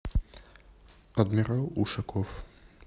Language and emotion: Russian, neutral